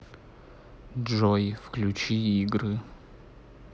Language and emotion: Russian, neutral